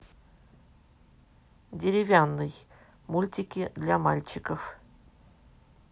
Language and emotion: Russian, neutral